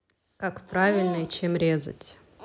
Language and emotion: Russian, neutral